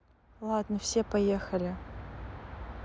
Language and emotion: Russian, neutral